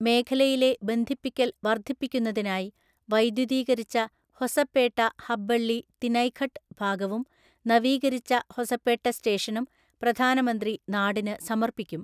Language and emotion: Malayalam, neutral